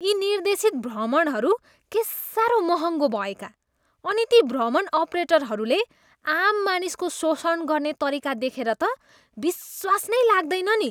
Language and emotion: Nepali, disgusted